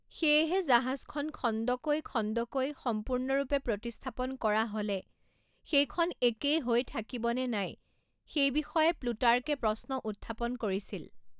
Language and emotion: Assamese, neutral